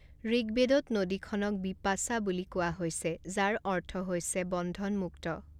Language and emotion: Assamese, neutral